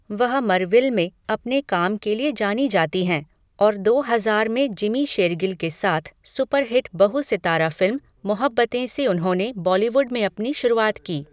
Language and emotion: Hindi, neutral